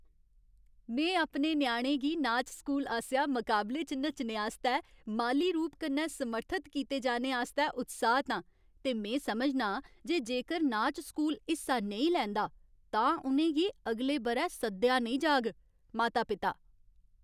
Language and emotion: Dogri, happy